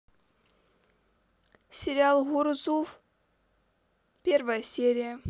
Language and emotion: Russian, neutral